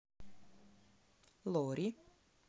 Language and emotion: Russian, neutral